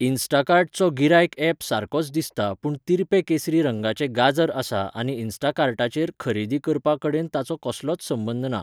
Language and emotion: Goan Konkani, neutral